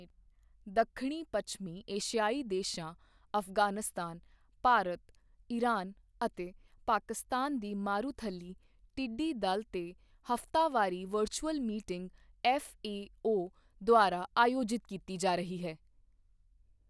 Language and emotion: Punjabi, neutral